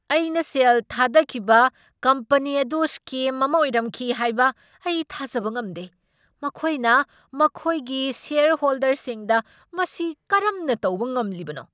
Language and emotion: Manipuri, angry